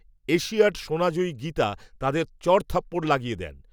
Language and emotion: Bengali, neutral